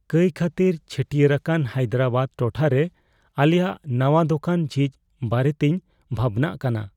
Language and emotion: Santali, fearful